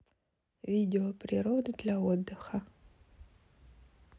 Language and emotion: Russian, neutral